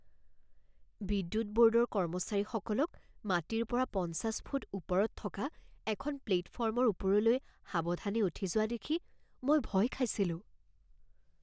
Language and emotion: Assamese, fearful